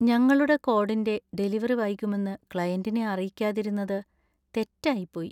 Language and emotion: Malayalam, sad